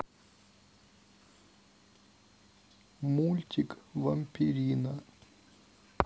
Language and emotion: Russian, neutral